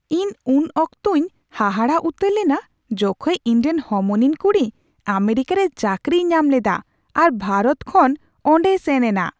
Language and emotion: Santali, surprised